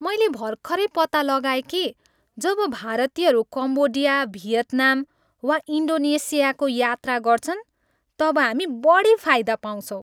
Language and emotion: Nepali, happy